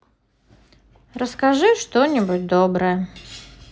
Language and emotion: Russian, neutral